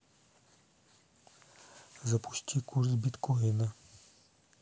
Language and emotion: Russian, neutral